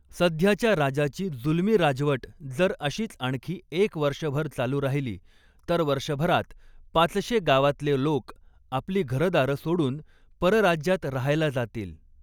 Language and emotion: Marathi, neutral